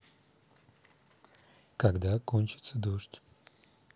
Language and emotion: Russian, neutral